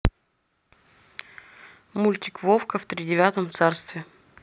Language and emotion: Russian, neutral